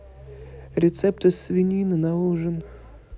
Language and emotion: Russian, neutral